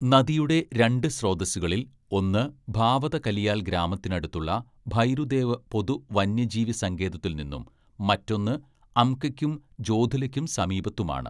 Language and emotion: Malayalam, neutral